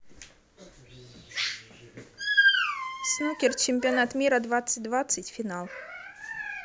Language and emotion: Russian, neutral